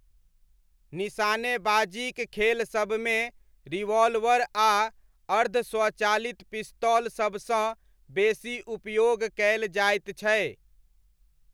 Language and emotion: Maithili, neutral